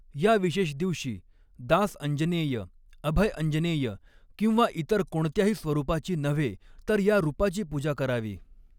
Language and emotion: Marathi, neutral